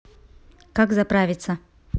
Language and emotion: Russian, neutral